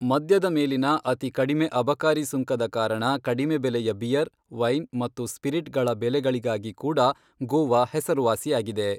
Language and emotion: Kannada, neutral